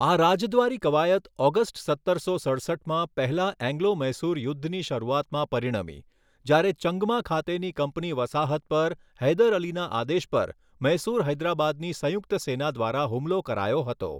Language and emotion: Gujarati, neutral